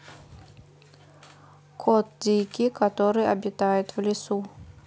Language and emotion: Russian, neutral